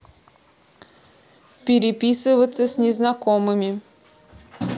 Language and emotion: Russian, neutral